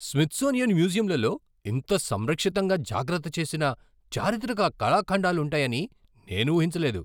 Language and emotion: Telugu, surprised